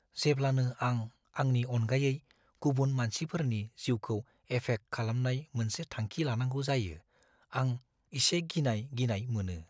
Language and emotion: Bodo, fearful